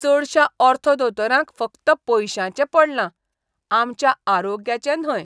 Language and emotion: Goan Konkani, disgusted